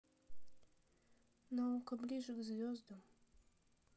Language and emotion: Russian, sad